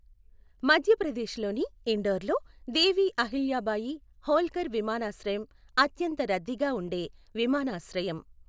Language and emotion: Telugu, neutral